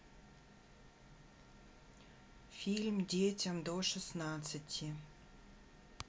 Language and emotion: Russian, neutral